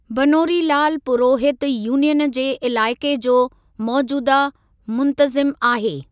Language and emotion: Sindhi, neutral